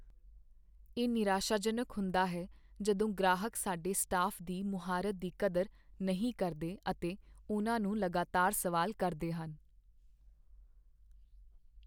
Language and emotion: Punjabi, sad